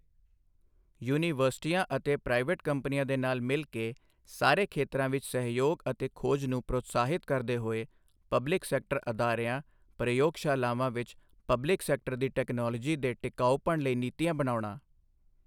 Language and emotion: Punjabi, neutral